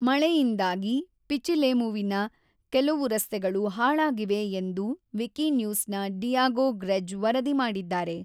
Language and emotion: Kannada, neutral